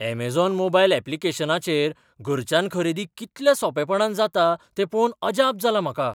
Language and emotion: Goan Konkani, surprised